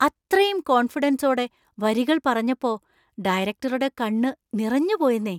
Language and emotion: Malayalam, surprised